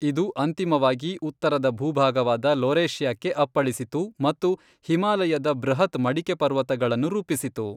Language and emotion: Kannada, neutral